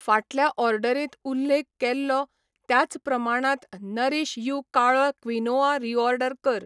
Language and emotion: Goan Konkani, neutral